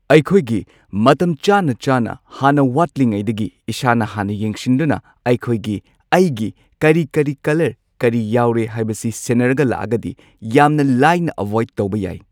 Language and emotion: Manipuri, neutral